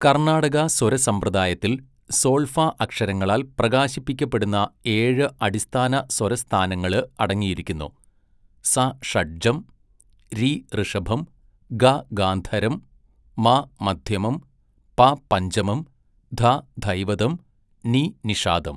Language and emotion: Malayalam, neutral